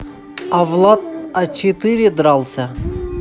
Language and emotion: Russian, neutral